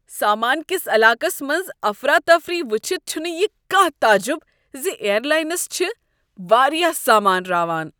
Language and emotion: Kashmiri, disgusted